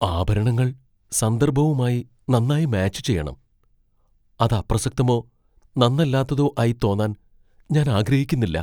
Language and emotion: Malayalam, fearful